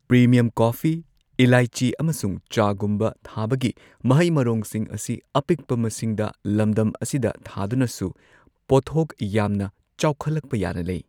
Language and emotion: Manipuri, neutral